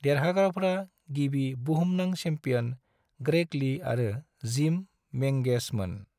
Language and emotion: Bodo, neutral